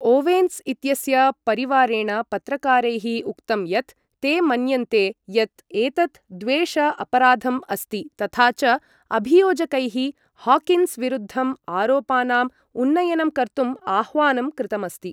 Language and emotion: Sanskrit, neutral